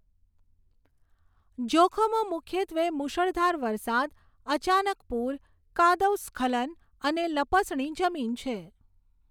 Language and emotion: Gujarati, neutral